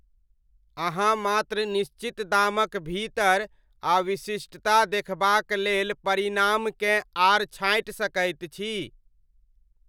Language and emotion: Maithili, neutral